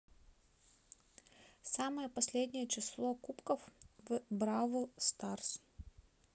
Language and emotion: Russian, neutral